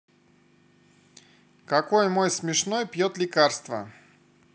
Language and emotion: Russian, neutral